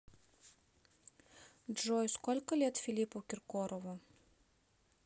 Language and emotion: Russian, neutral